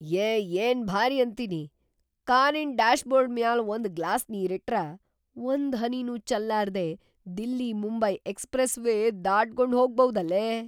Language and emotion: Kannada, surprised